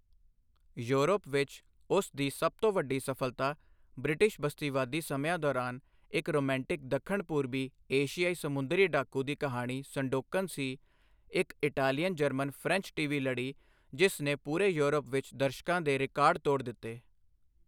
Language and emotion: Punjabi, neutral